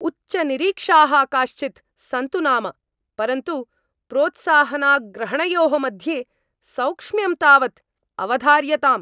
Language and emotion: Sanskrit, angry